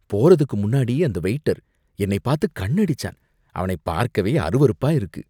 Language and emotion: Tamil, disgusted